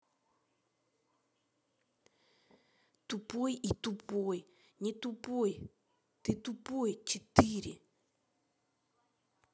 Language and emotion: Russian, angry